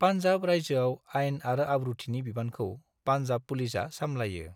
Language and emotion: Bodo, neutral